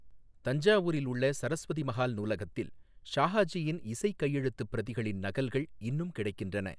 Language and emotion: Tamil, neutral